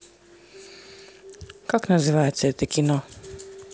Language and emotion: Russian, neutral